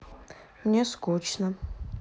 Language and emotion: Russian, neutral